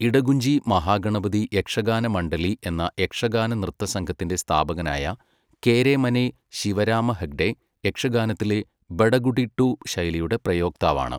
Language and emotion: Malayalam, neutral